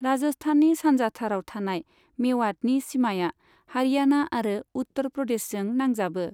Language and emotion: Bodo, neutral